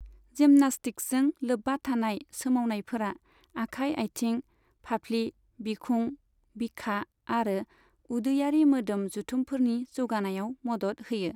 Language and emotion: Bodo, neutral